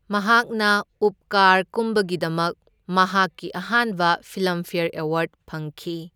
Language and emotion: Manipuri, neutral